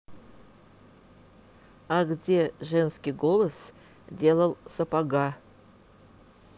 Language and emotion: Russian, neutral